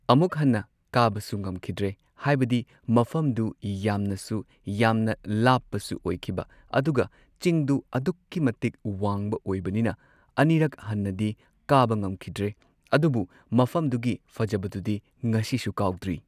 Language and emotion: Manipuri, neutral